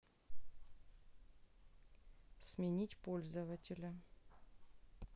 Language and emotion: Russian, neutral